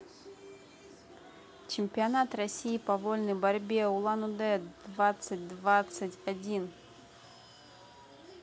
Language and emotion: Russian, neutral